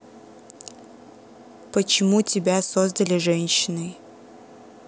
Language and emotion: Russian, neutral